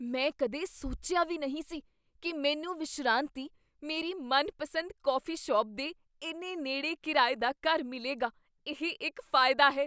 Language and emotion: Punjabi, surprised